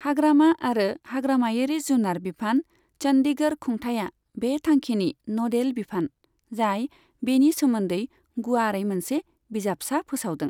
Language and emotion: Bodo, neutral